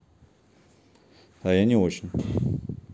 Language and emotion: Russian, neutral